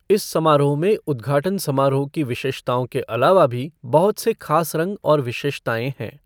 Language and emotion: Hindi, neutral